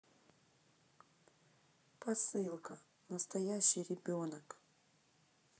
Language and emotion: Russian, neutral